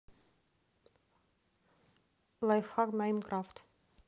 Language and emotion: Russian, neutral